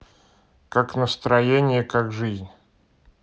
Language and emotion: Russian, neutral